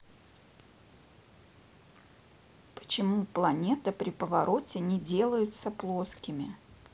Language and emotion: Russian, neutral